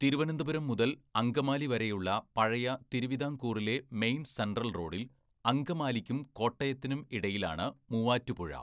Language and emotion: Malayalam, neutral